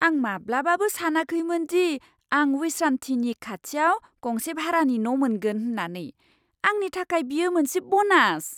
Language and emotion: Bodo, surprised